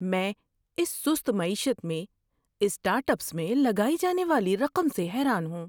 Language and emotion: Urdu, surprised